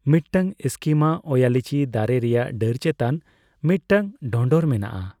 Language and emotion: Santali, neutral